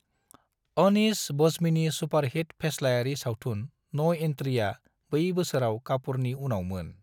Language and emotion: Bodo, neutral